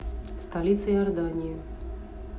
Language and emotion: Russian, neutral